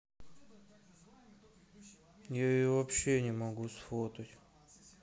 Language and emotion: Russian, sad